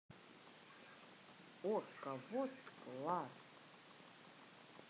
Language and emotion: Russian, positive